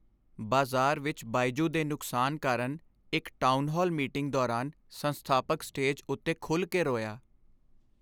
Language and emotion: Punjabi, sad